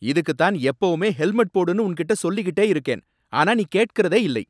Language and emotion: Tamil, angry